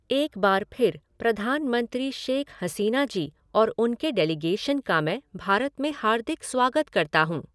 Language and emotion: Hindi, neutral